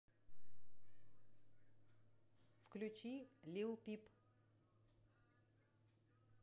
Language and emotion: Russian, neutral